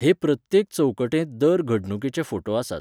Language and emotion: Goan Konkani, neutral